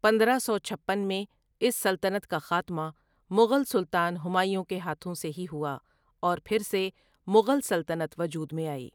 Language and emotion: Urdu, neutral